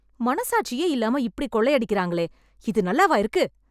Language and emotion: Tamil, angry